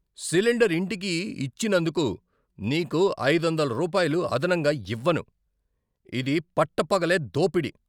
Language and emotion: Telugu, angry